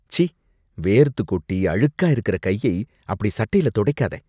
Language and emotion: Tamil, disgusted